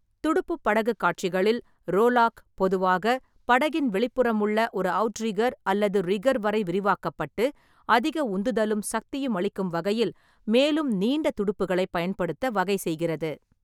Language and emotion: Tamil, neutral